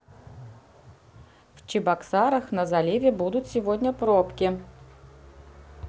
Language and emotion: Russian, neutral